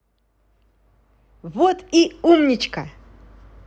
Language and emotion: Russian, positive